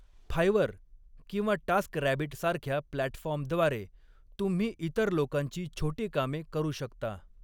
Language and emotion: Marathi, neutral